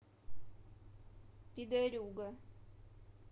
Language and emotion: Russian, neutral